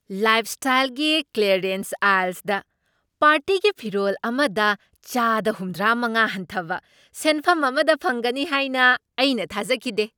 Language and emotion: Manipuri, surprised